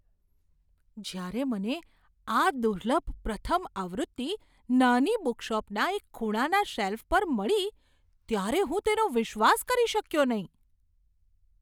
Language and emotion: Gujarati, surprised